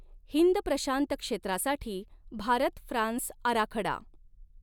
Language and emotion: Marathi, neutral